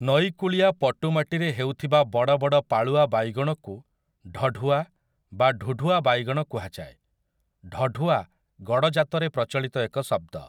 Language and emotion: Odia, neutral